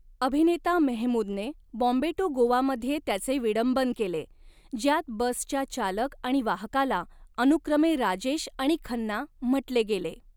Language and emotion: Marathi, neutral